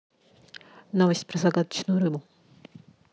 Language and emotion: Russian, neutral